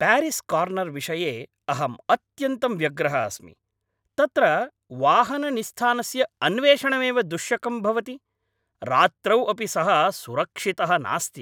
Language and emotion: Sanskrit, angry